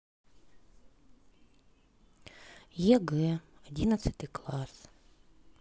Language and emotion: Russian, sad